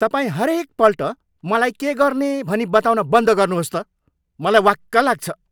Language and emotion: Nepali, angry